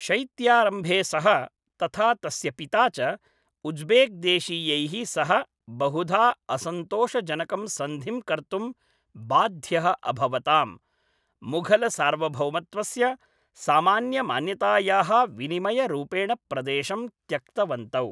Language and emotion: Sanskrit, neutral